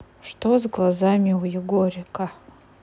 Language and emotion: Russian, neutral